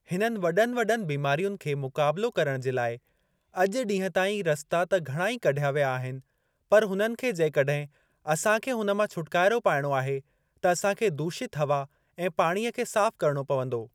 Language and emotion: Sindhi, neutral